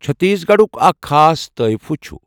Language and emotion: Kashmiri, neutral